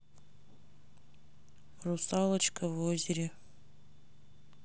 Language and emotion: Russian, sad